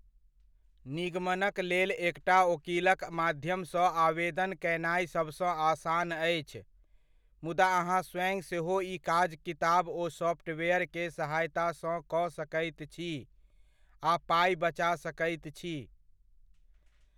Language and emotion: Maithili, neutral